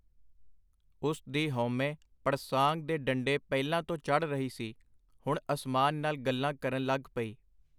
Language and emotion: Punjabi, neutral